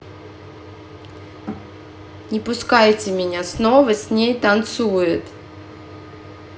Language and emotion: Russian, angry